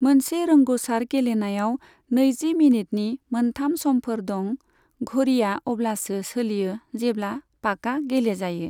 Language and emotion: Bodo, neutral